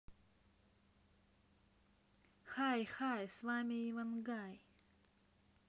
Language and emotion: Russian, positive